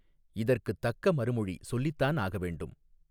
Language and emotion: Tamil, neutral